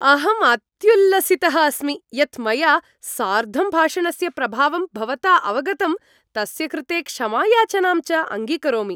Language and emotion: Sanskrit, happy